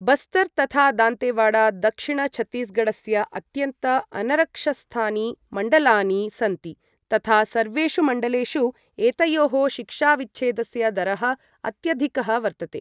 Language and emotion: Sanskrit, neutral